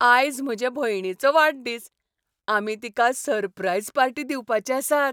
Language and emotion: Goan Konkani, happy